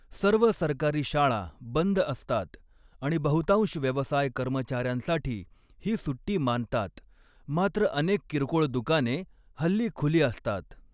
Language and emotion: Marathi, neutral